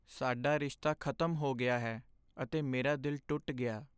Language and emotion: Punjabi, sad